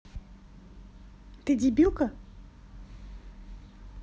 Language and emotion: Russian, angry